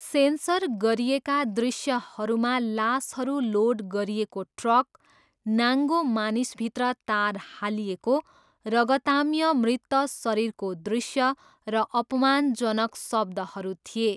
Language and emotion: Nepali, neutral